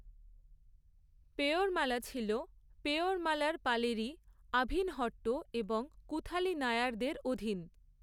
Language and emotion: Bengali, neutral